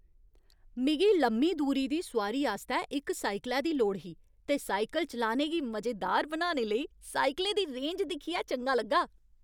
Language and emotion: Dogri, happy